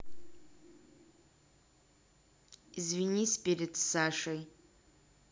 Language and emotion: Russian, angry